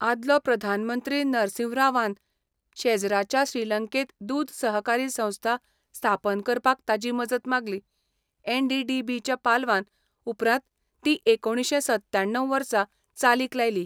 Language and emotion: Goan Konkani, neutral